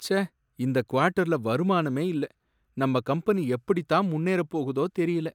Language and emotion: Tamil, sad